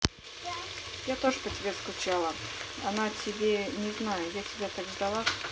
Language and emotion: Russian, neutral